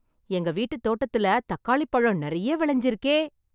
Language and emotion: Tamil, happy